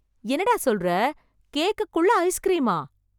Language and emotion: Tamil, surprised